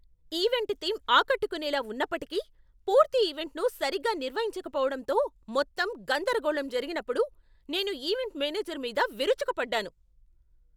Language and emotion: Telugu, angry